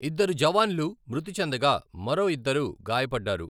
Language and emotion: Telugu, neutral